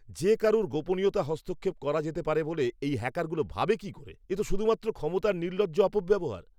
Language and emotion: Bengali, angry